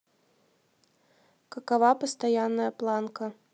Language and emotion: Russian, neutral